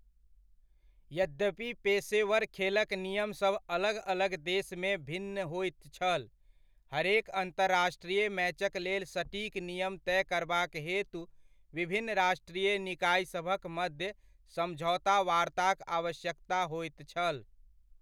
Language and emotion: Maithili, neutral